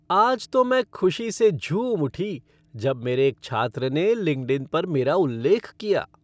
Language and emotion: Hindi, happy